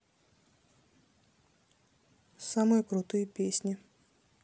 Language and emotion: Russian, neutral